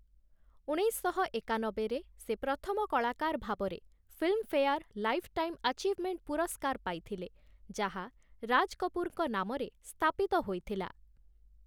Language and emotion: Odia, neutral